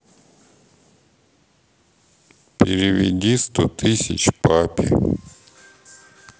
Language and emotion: Russian, neutral